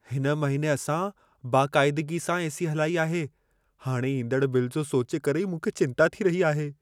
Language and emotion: Sindhi, fearful